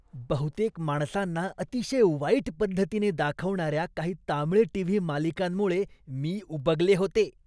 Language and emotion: Marathi, disgusted